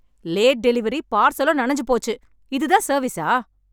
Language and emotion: Tamil, angry